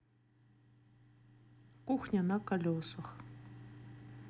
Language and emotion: Russian, neutral